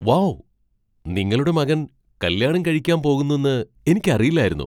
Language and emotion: Malayalam, surprised